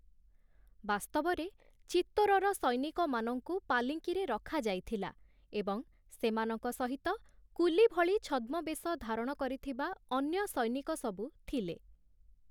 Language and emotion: Odia, neutral